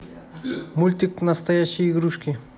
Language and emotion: Russian, neutral